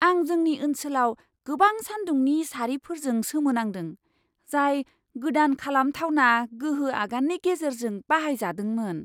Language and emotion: Bodo, surprised